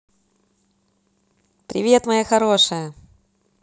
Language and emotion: Russian, positive